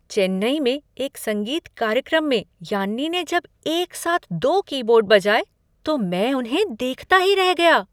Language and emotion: Hindi, surprised